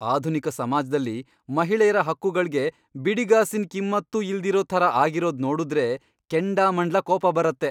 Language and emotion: Kannada, angry